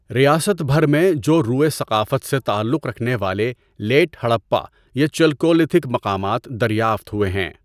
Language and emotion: Urdu, neutral